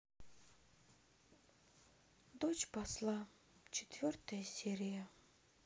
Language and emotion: Russian, sad